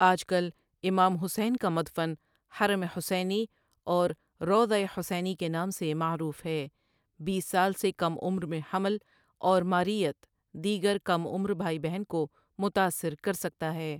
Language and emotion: Urdu, neutral